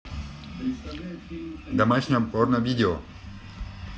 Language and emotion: Russian, neutral